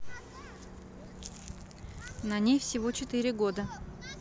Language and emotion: Russian, neutral